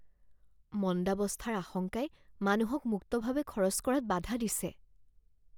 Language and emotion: Assamese, fearful